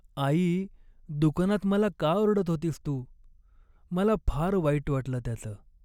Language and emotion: Marathi, sad